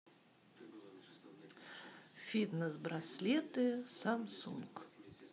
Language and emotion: Russian, neutral